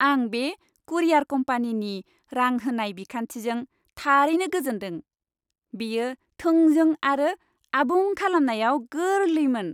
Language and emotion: Bodo, happy